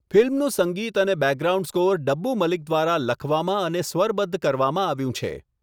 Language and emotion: Gujarati, neutral